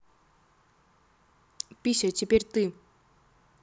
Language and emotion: Russian, neutral